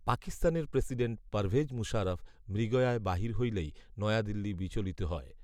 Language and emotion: Bengali, neutral